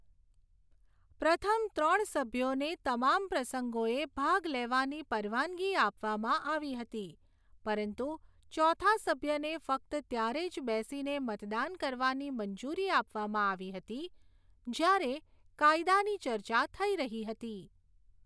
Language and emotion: Gujarati, neutral